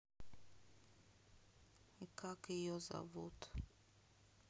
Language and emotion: Russian, sad